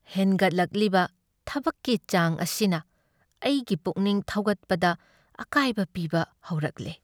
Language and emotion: Manipuri, sad